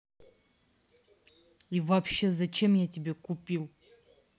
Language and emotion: Russian, angry